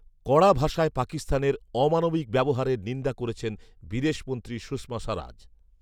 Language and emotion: Bengali, neutral